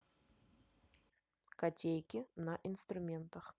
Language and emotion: Russian, neutral